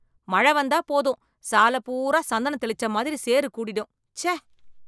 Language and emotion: Tamil, disgusted